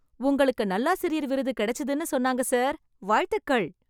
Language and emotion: Tamil, happy